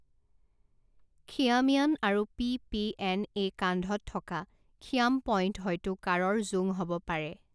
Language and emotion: Assamese, neutral